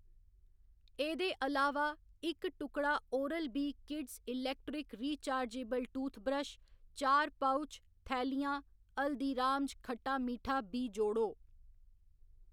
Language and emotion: Dogri, neutral